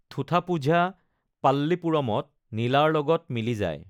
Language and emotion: Assamese, neutral